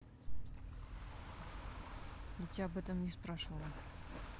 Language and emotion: Russian, angry